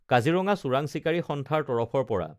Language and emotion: Assamese, neutral